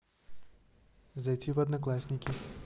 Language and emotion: Russian, neutral